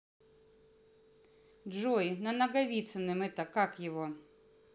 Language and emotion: Russian, neutral